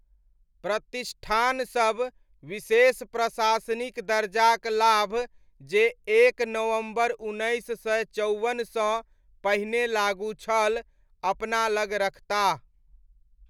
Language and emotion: Maithili, neutral